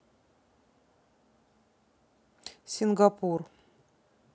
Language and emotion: Russian, neutral